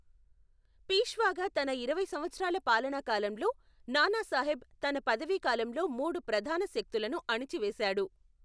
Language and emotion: Telugu, neutral